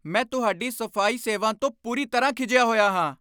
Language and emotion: Punjabi, angry